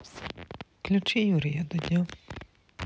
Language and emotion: Russian, neutral